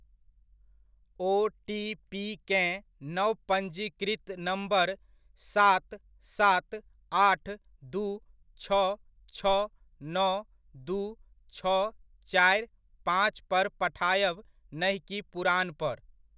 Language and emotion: Maithili, neutral